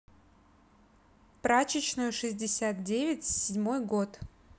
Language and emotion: Russian, neutral